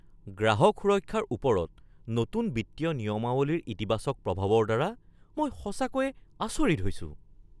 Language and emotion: Assamese, surprised